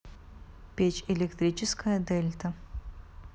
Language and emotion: Russian, neutral